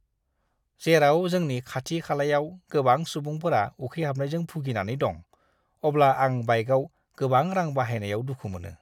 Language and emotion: Bodo, disgusted